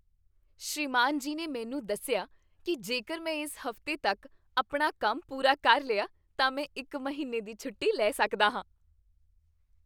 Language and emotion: Punjabi, happy